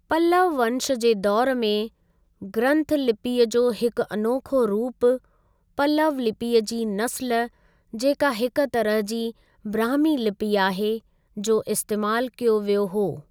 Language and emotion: Sindhi, neutral